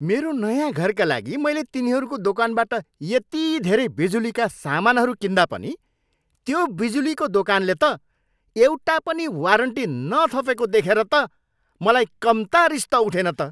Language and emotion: Nepali, angry